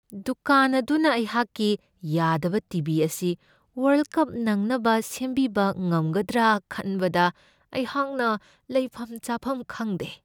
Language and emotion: Manipuri, fearful